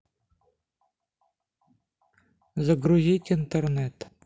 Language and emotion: Russian, neutral